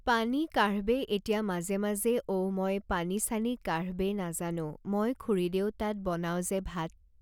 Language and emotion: Assamese, neutral